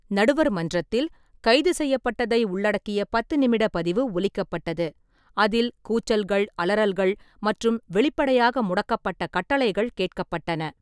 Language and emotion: Tamil, neutral